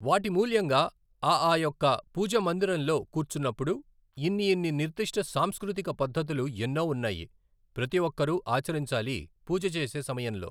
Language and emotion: Telugu, neutral